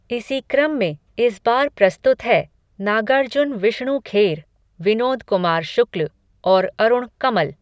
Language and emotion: Hindi, neutral